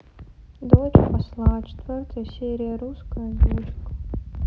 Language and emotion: Russian, sad